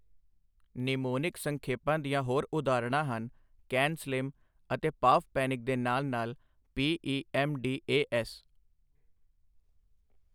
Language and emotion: Punjabi, neutral